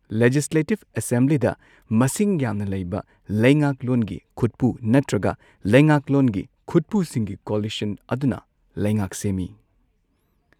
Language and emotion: Manipuri, neutral